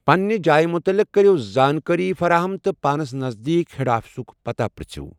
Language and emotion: Kashmiri, neutral